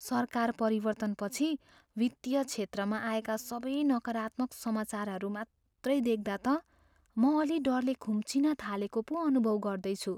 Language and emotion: Nepali, fearful